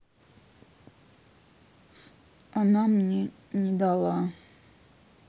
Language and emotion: Russian, sad